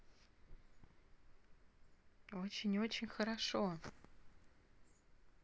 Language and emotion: Russian, positive